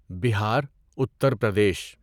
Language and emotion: Urdu, neutral